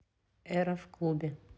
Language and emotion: Russian, neutral